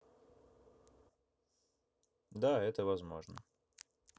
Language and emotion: Russian, neutral